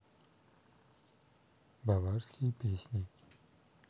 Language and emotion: Russian, neutral